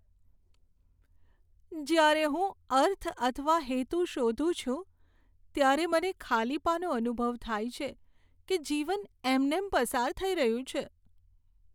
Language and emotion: Gujarati, sad